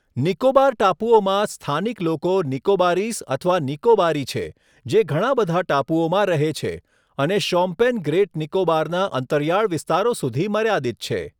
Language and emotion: Gujarati, neutral